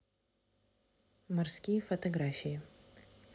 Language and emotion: Russian, neutral